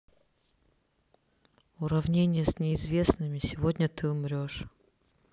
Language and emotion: Russian, sad